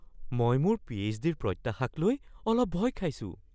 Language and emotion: Assamese, fearful